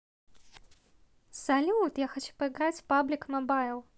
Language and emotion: Russian, positive